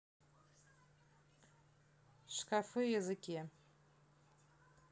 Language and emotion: Russian, neutral